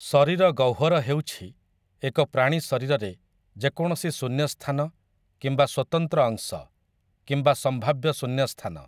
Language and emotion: Odia, neutral